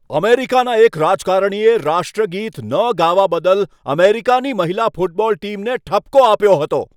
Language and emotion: Gujarati, angry